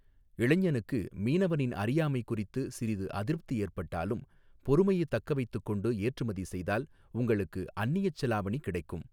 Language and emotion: Tamil, neutral